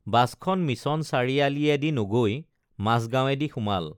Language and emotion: Assamese, neutral